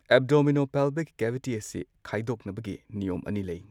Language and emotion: Manipuri, neutral